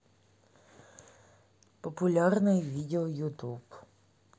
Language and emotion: Russian, neutral